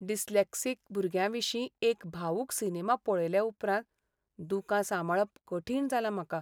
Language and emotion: Goan Konkani, sad